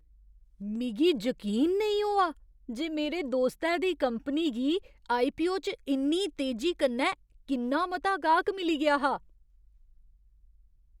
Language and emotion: Dogri, surprised